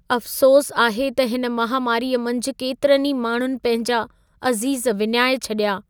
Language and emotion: Sindhi, sad